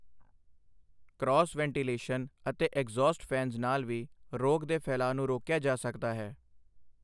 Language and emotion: Punjabi, neutral